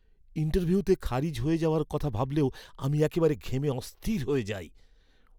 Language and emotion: Bengali, fearful